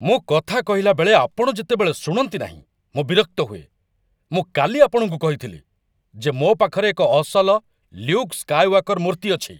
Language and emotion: Odia, angry